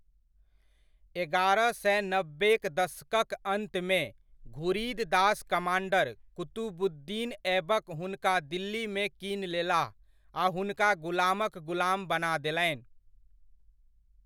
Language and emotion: Maithili, neutral